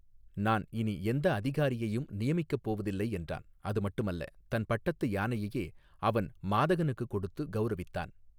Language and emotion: Tamil, neutral